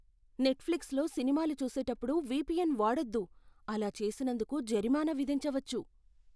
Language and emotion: Telugu, fearful